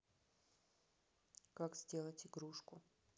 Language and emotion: Russian, neutral